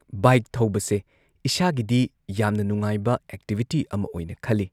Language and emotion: Manipuri, neutral